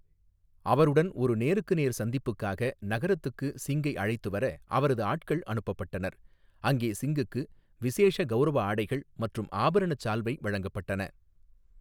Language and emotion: Tamil, neutral